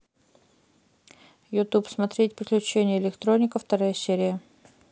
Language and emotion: Russian, neutral